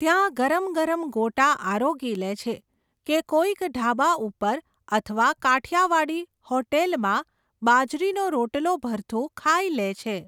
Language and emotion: Gujarati, neutral